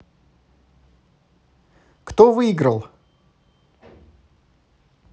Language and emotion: Russian, positive